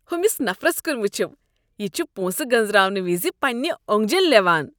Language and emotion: Kashmiri, disgusted